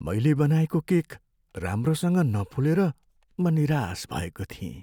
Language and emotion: Nepali, sad